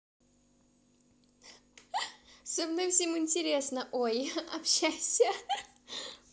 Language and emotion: Russian, positive